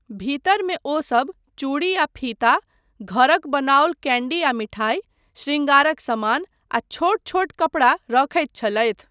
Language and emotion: Maithili, neutral